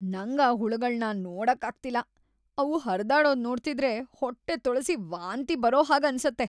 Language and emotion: Kannada, disgusted